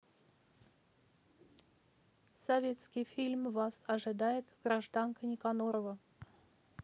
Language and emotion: Russian, neutral